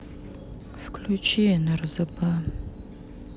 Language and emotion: Russian, sad